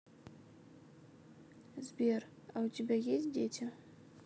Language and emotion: Russian, neutral